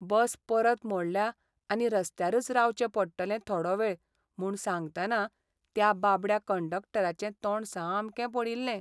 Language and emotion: Goan Konkani, sad